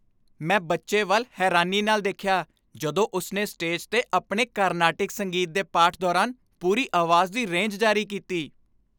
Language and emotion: Punjabi, happy